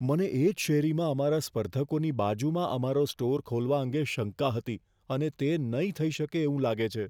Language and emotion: Gujarati, fearful